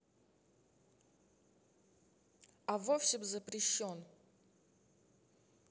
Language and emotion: Russian, neutral